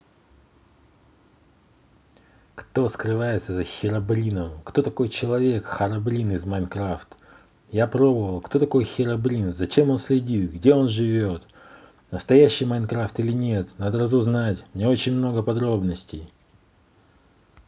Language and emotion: Russian, neutral